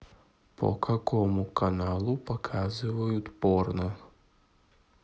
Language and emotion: Russian, neutral